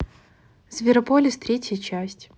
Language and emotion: Russian, neutral